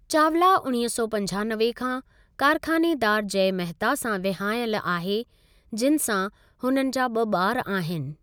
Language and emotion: Sindhi, neutral